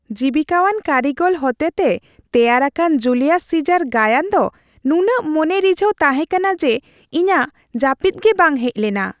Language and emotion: Santali, happy